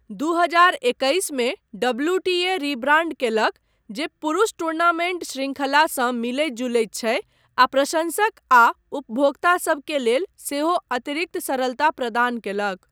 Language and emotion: Maithili, neutral